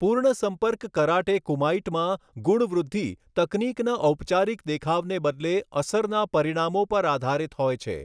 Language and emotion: Gujarati, neutral